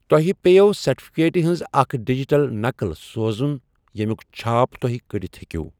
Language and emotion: Kashmiri, neutral